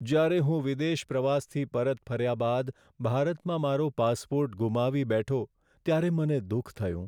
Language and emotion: Gujarati, sad